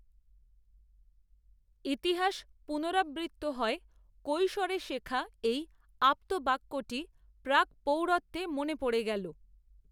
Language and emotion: Bengali, neutral